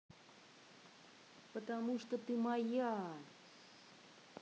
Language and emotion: Russian, neutral